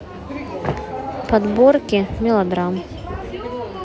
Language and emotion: Russian, neutral